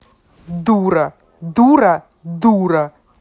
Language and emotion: Russian, angry